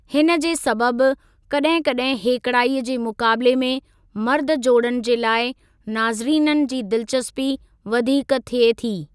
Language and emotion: Sindhi, neutral